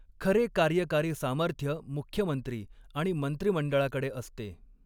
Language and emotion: Marathi, neutral